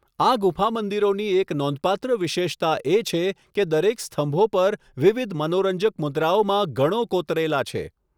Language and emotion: Gujarati, neutral